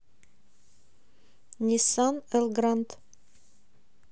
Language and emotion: Russian, neutral